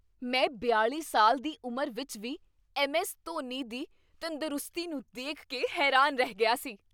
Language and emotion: Punjabi, surprised